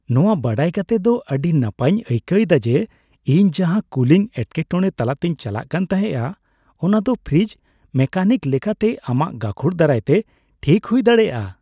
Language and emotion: Santali, happy